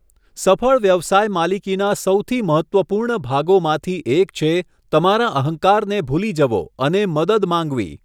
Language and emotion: Gujarati, neutral